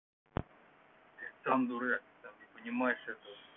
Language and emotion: Russian, neutral